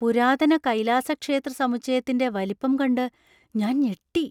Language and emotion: Malayalam, surprised